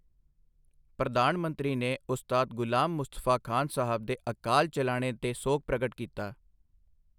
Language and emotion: Punjabi, neutral